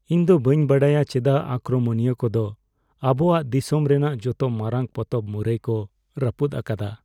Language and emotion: Santali, sad